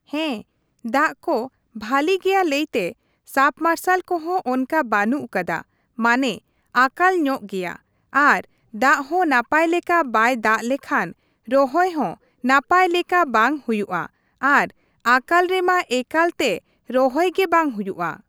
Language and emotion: Santali, neutral